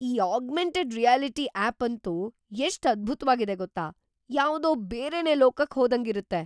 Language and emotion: Kannada, surprised